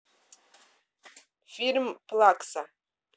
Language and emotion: Russian, neutral